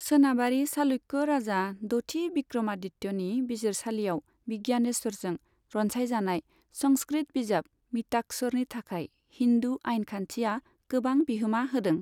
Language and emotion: Bodo, neutral